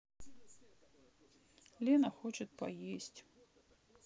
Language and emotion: Russian, sad